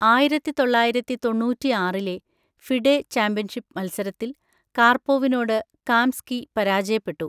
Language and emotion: Malayalam, neutral